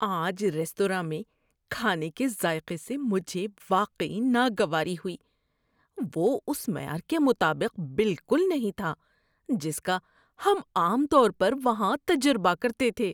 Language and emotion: Urdu, disgusted